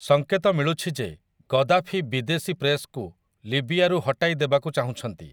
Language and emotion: Odia, neutral